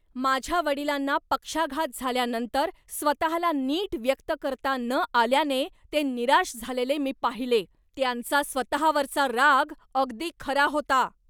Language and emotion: Marathi, angry